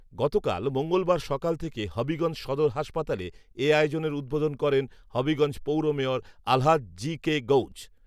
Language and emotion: Bengali, neutral